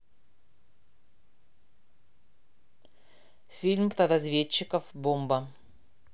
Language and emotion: Russian, neutral